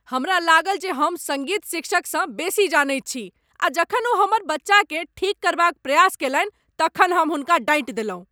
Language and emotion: Maithili, angry